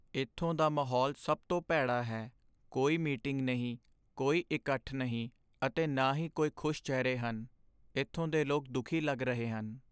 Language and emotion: Punjabi, sad